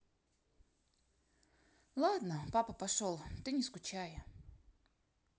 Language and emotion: Russian, sad